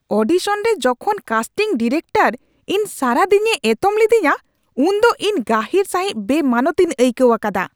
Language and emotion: Santali, angry